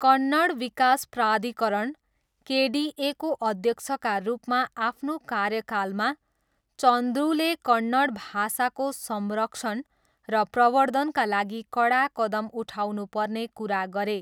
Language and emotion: Nepali, neutral